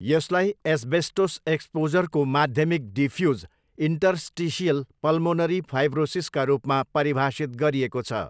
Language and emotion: Nepali, neutral